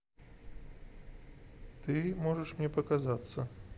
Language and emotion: Russian, neutral